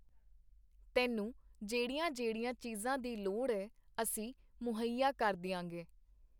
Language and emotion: Punjabi, neutral